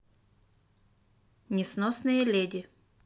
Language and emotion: Russian, neutral